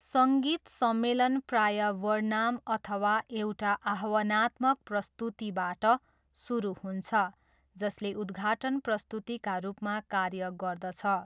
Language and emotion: Nepali, neutral